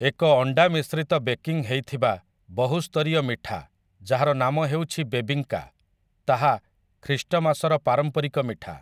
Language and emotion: Odia, neutral